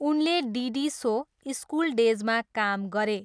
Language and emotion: Nepali, neutral